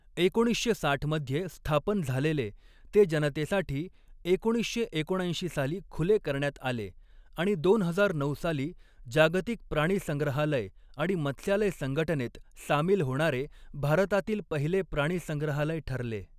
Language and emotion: Marathi, neutral